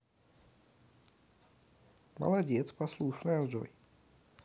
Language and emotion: Russian, positive